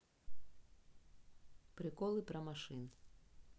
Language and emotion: Russian, neutral